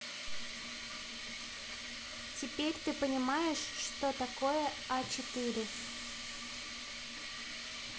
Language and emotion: Russian, neutral